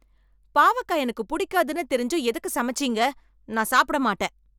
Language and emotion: Tamil, angry